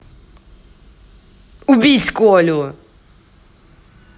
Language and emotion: Russian, angry